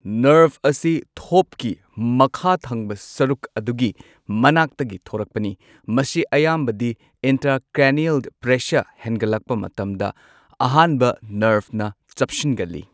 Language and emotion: Manipuri, neutral